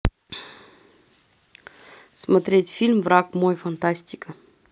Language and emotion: Russian, neutral